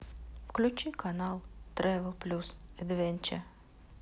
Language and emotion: Russian, sad